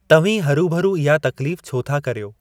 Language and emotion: Sindhi, neutral